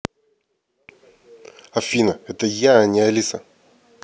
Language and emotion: Russian, angry